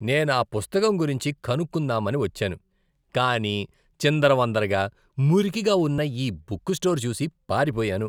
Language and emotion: Telugu, disgusted